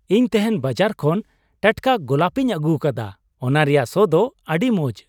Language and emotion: Santali, happy